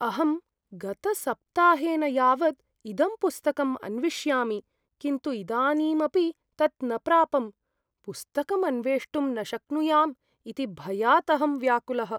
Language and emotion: Sanskrit, fearful